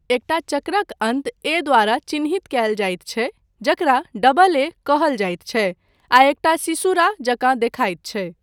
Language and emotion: Maithili, neutral